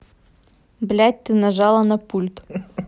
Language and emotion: Russian, angry